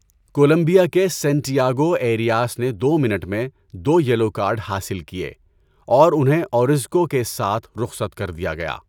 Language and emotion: Urdu, neutral